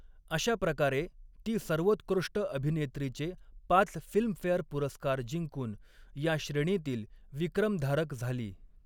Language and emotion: Marathi, neutral